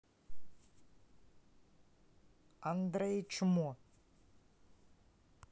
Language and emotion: Russian, neutral